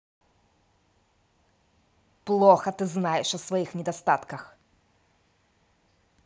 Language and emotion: Russian, angry